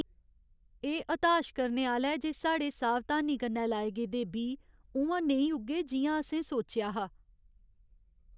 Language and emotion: Dogri, sad